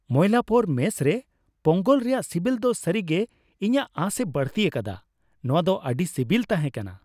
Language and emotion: Santali, happy